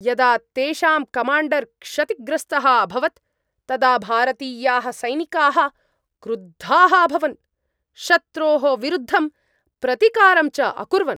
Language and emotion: Sanskrit, angry